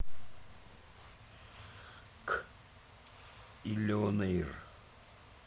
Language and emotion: Russian, neutral